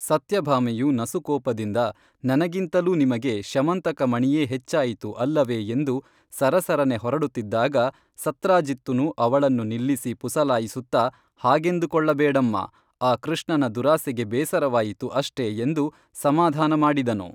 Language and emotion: Kannada, neutral